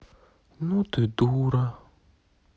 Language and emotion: Russian, sad